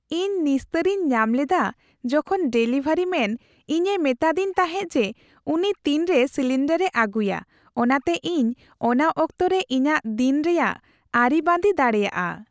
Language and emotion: Santali, happy